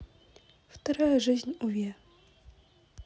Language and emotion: Russian, neutral